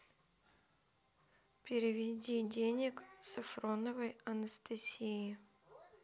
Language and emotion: Russian, neutral